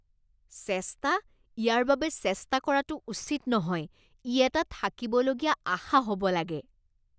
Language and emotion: Assamese, disgusted